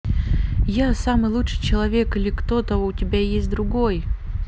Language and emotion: Russian, positive